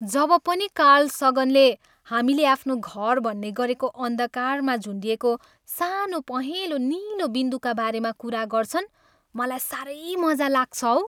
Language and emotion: Nepali, happy